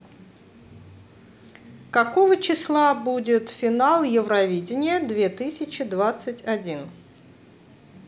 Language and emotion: Russian, neutral